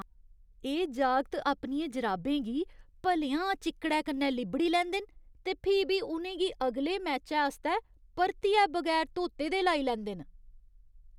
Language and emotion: Dogri, disgusted